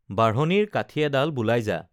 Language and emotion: Assamese, neutral